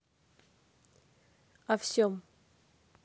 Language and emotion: Russian, neutral